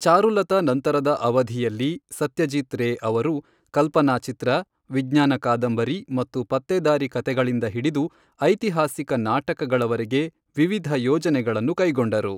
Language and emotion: Kannada, neutral